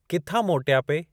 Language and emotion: Sindhi, neutral